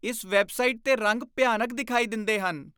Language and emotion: Punjabi, disgusted